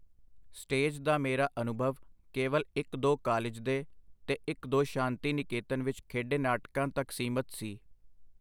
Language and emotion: Punjabi, neutral